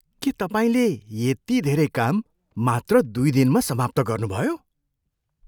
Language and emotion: Nepali, surprised